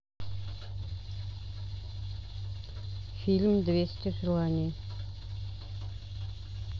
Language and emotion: Russian, neutral